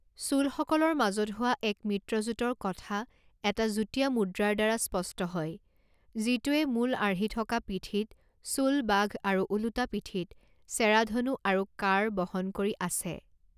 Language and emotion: Assamese, neutral